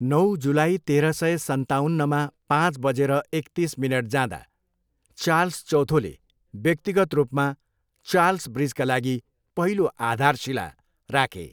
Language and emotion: Nepali, neutral